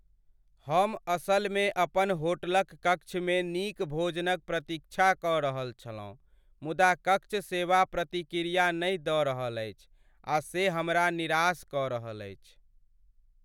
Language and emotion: Maithili, sad